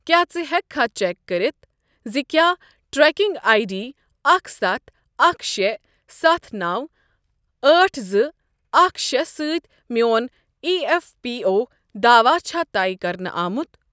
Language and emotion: Kashmiri, neutral